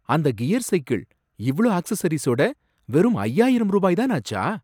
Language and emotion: Tamil, surprised